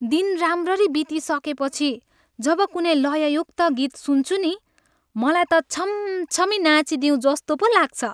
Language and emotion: Nepali, happy